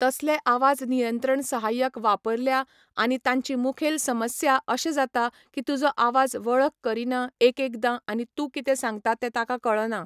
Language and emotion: Goan Konkani, neutral